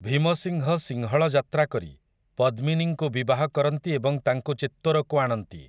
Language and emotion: Odia, neutral